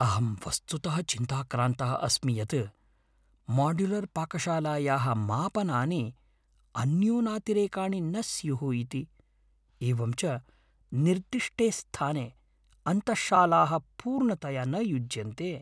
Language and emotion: Sanskrit, fearful